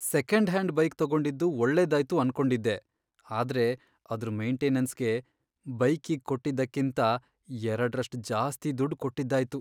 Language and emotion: Kannada, sad